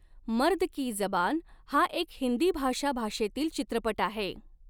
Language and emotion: Marathi, neutral